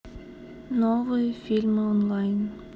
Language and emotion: Russian, sad